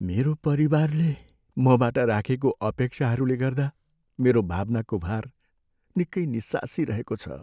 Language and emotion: Nepali, sad